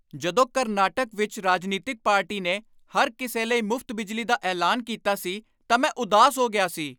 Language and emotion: Punjabi, angry